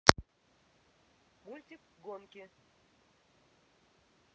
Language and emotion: Russian, neutral